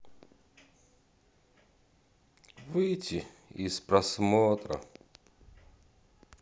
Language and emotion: Russian, sad